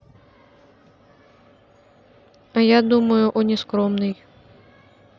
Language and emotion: Russian, neutral